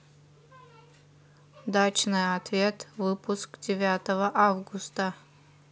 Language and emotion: Russian, neutral